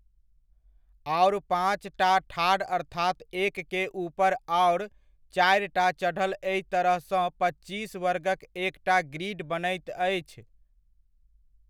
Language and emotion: Maithili, neutral